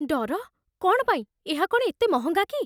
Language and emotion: Odia, fearful